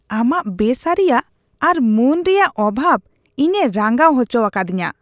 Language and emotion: Santali, disgusted